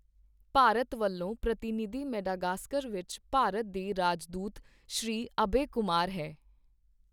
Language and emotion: Punjabi, neutral